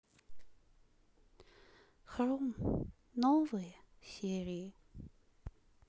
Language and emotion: Russian, sad